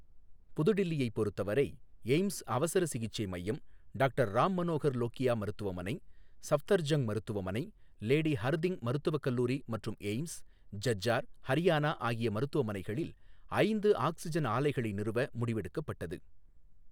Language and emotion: Tamil, neutral